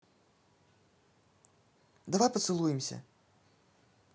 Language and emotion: Russian, neutral